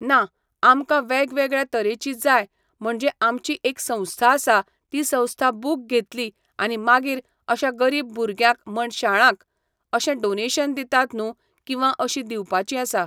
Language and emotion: Goan Konkani, neutral